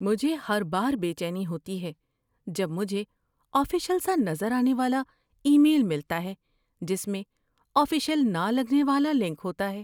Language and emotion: Urdu, fearful